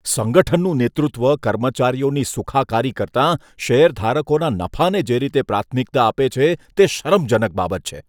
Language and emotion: Gujarati, disgusted